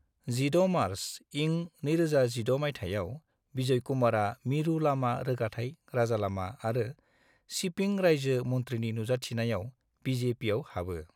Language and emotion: Bodo, neutral